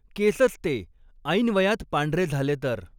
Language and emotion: Marathi, neutral